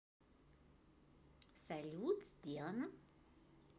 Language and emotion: Russian, positive